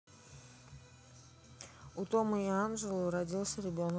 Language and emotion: Russian, neutral